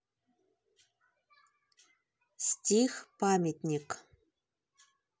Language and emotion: Russian, neutral